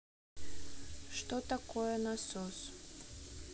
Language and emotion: Russian, neutral